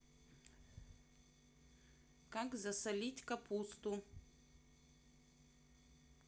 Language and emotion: Russian, neutral